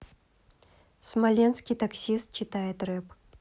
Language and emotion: Russian, neutral